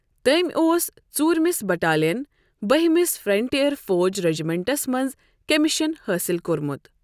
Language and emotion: Kashmiri, neutral